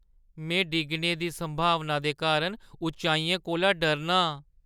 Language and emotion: Dogri, fearful